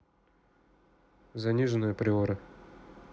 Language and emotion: Russian, neutral